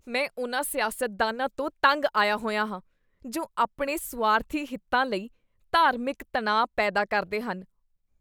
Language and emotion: Punjabi, disgusted